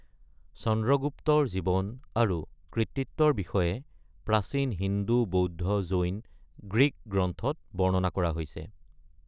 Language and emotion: Assamese, neutral